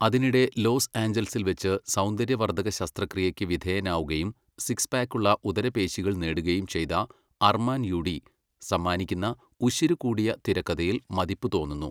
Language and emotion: Malayalam, neutral